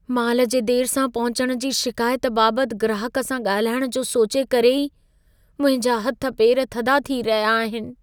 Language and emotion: Sindhi, fearful